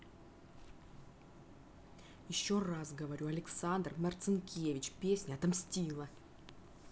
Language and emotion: Russian, angry